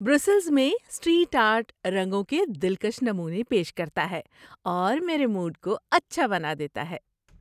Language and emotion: Urdu, happy